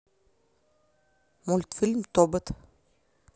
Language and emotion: Russian, neutral